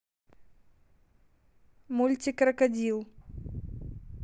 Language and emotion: Russian, neutral